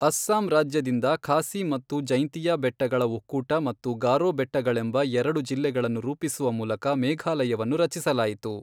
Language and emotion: Kannada, neutral